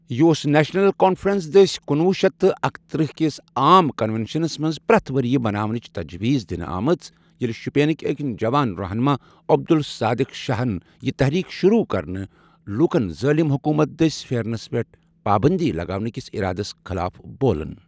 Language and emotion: Kashmiri, neutral